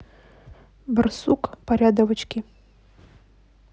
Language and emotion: Russian, neutral